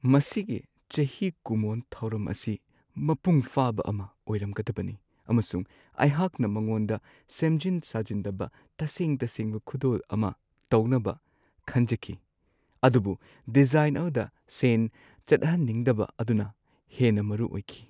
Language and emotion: Manipuri, sad